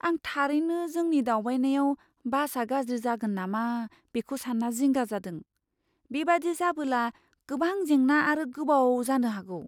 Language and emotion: Bodo, fearful